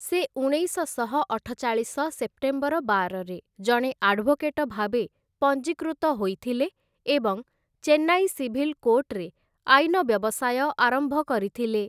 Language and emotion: Odia, neutral